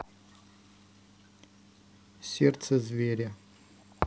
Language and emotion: Russian, neutral